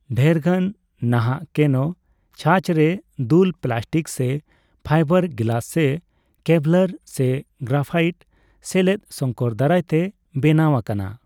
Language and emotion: Santali, neutral